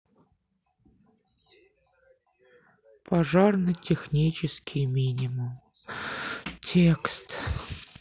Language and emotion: Russian, sad